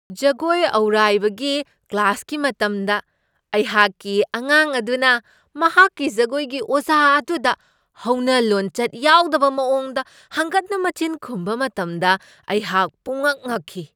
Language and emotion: Manipuri, surprised